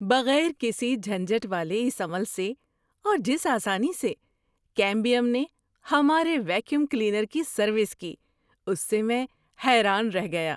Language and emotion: Urdu, surprised